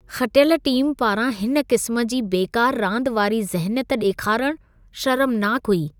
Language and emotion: Sindhi, disgusted